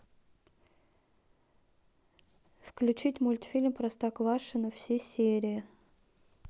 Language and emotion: Russian, neutral